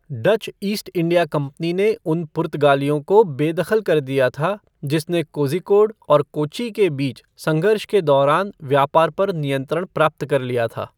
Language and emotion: Hindi, neutral